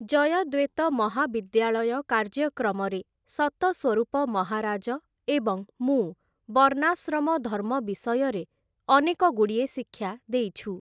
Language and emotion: Odia, neutral